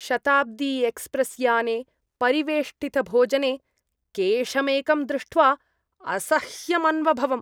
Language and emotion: Sanskrit, disgusted